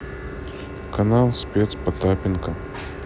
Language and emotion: Russian, neutral